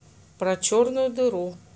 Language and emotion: Russian, neutral